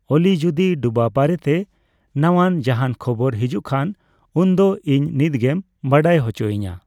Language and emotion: Santali, neutral